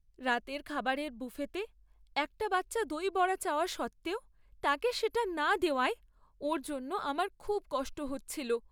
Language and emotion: Bengali, sad